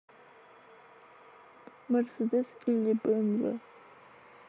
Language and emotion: Russian, sad